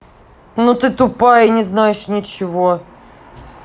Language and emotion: Russian, angry